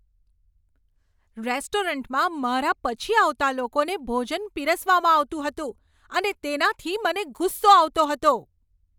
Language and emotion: Gujarati, angry